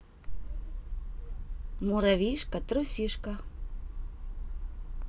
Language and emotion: Russian, neutral